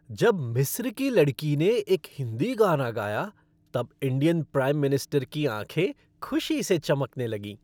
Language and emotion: Hindi, happy